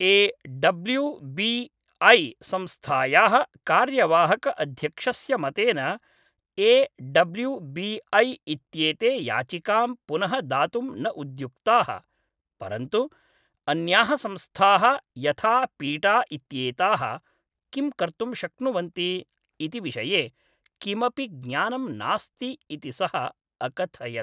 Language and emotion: Sanskrit, neutral